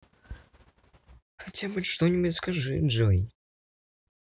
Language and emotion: Russian, neutral